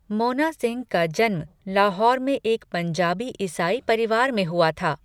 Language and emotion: Hindi, neutral